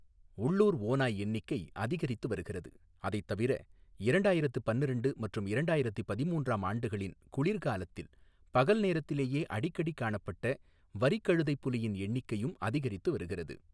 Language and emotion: Tamil, neutral